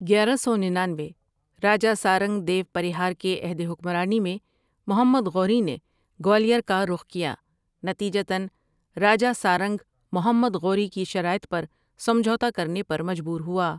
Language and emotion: Urdu, neutral